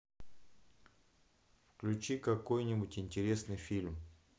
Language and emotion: Russian, neutral